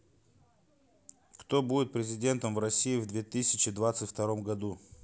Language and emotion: Russian, neutral